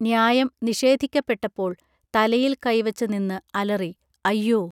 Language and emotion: Malayalam, neutral